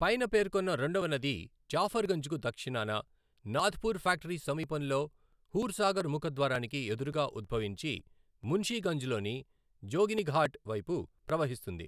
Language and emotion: Telugu, neutral